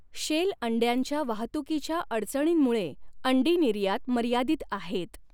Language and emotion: Marathi, neutral